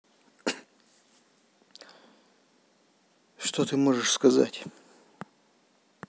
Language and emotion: Russian, angry